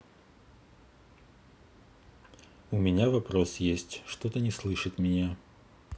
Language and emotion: Russian, neutral